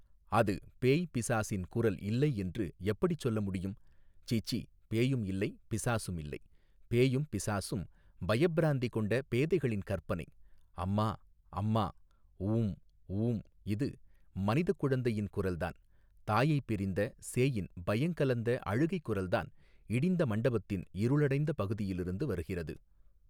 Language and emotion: Tamil, neutral